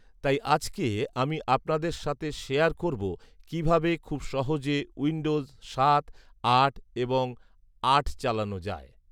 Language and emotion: Bengali, neutral